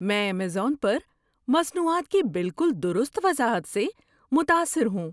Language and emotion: Urdu, surprised